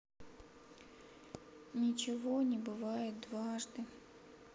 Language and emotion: Russian, sad